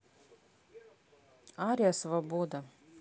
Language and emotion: Russian, neutral